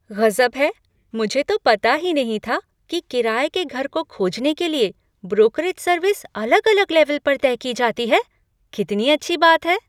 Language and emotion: Hindi, surprised